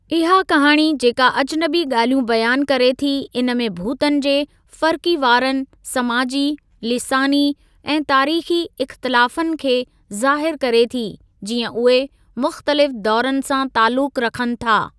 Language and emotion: Sindhi, neutral